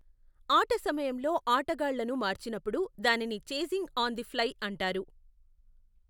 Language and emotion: Telugu, neutral